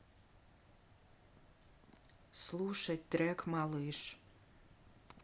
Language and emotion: Russian, sad